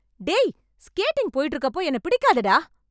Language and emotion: Tamil, angry